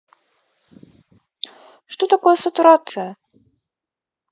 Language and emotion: Russian, neutral